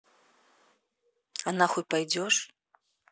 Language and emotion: Russian, neutral